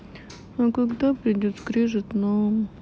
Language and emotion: Russian, sad